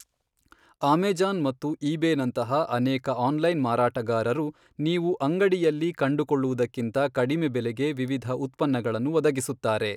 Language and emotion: Kannada, neutral